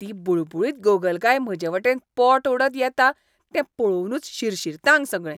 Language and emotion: Goan Konkani, disgusted